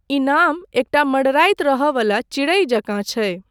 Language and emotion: Maithili, neutral